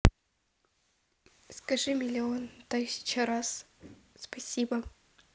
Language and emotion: Russian, neutral